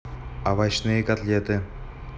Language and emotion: Russian, neutral